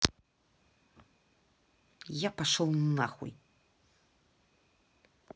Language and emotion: Russian, angry